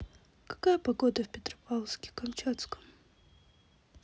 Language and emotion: Russian, sad